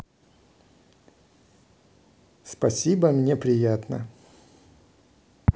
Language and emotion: Russian, positive